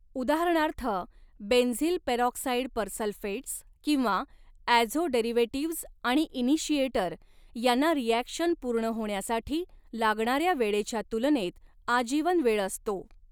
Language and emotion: Marathi, neutral